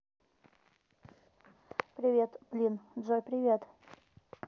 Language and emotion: Russian, neutral